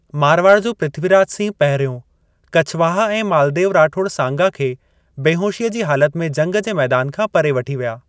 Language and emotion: Sindhi, neutral